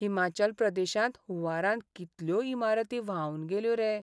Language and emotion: Goan Konkani, sad